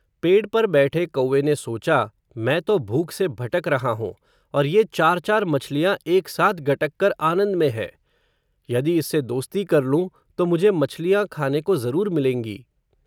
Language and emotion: Hindi, neutral